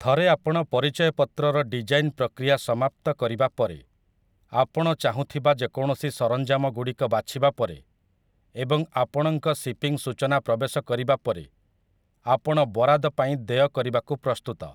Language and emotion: Odia, neutral